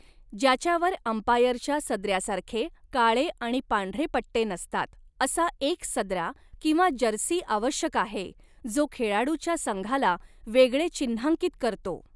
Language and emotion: Marathi, neutral